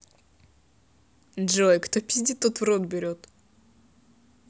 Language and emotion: Russian, neutral